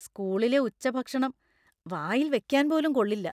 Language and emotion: Malayalam, disgusted